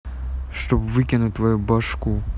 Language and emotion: Russian, angry